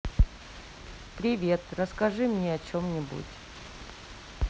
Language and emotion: Russian, neutral